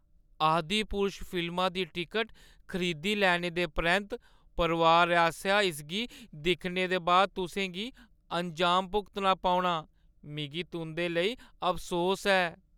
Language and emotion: Dogri, sad